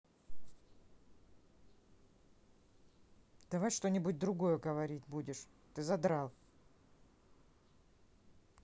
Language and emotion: Russian, angry